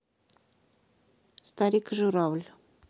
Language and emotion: Russian, neutral